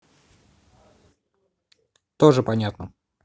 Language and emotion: Russian, neutral